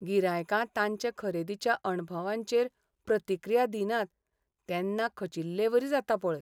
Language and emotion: Goan Konkani, sad